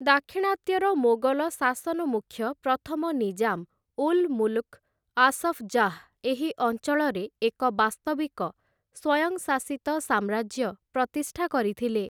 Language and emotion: Odia, neutral